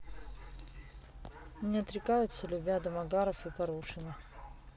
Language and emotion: Russian, neutral